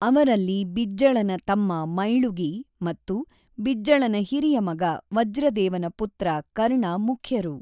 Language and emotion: Kannada, neutral